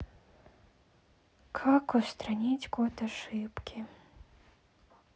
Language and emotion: Russian, sad